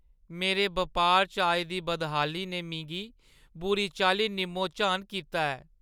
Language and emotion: Dogri, sad